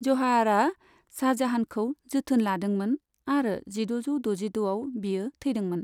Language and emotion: Bodo, neutral